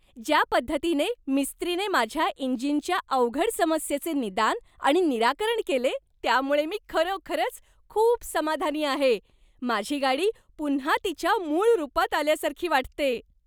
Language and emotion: Marathi, happy